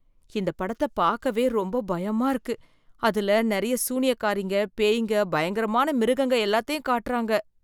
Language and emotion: Tamil, fearful